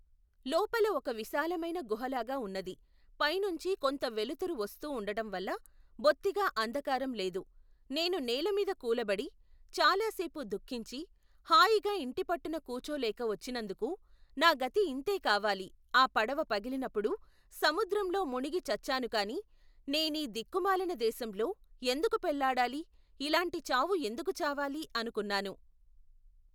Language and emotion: Telugu, neutral